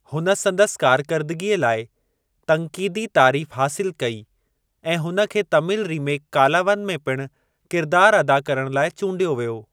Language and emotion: Sindhi, neutral